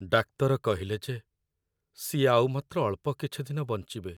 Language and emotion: Odia, sad